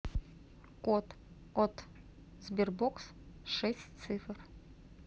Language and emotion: Russian, neutral